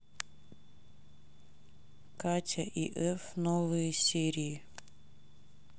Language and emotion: Russian, neutral